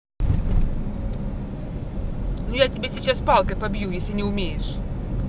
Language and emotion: Russian, angry